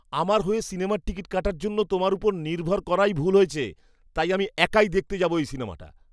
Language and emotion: Bengali, disgusted